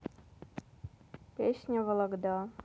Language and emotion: Russian, neutral